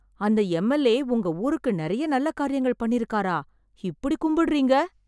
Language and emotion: Tamil, surprised